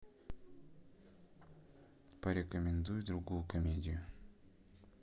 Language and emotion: Russian, neutral